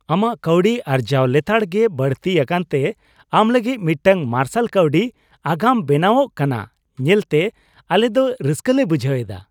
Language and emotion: Santali, happy